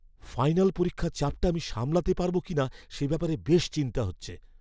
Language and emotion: Bengali, fearful